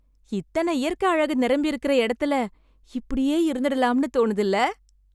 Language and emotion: Tamil, happy